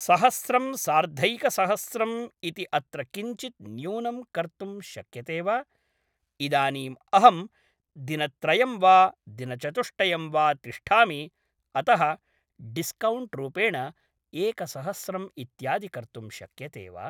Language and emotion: Sanskrit, neutral